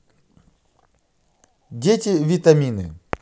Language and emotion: Russian, positive